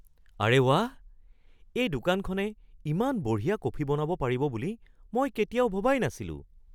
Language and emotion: Assamese, surprised